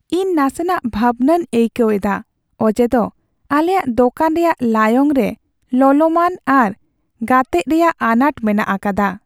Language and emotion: Santali, sad